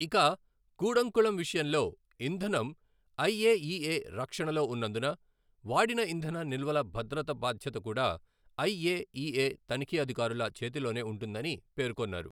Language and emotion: Telugu, neutral